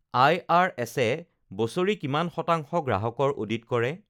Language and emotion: Assamese, neutral